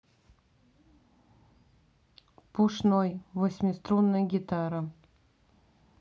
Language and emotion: Russian, neutral